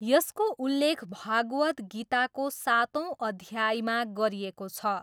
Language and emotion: Nepali, neutral